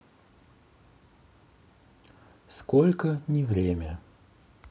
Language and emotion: Russian, neutral